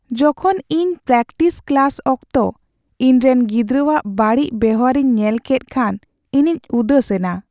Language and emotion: Santali, sad